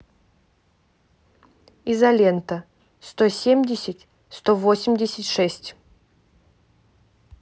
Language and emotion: Russian, neutral